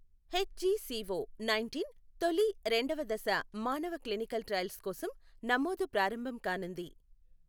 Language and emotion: Telugu, neutral